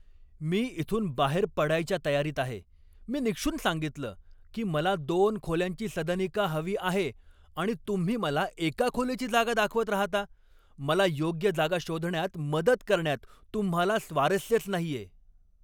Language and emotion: Marathi, angry